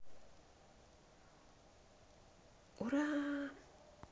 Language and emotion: Russian, positive